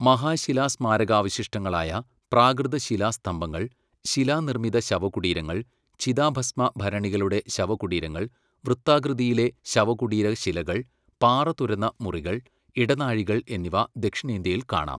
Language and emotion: Malayalam, neutral